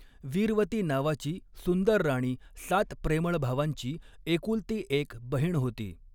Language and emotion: Marathi, neutral